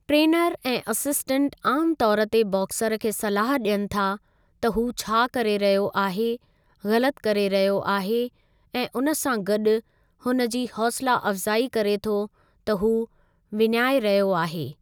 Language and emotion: Sindhi, neutral